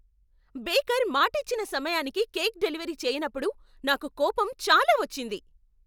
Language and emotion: Telugu, angry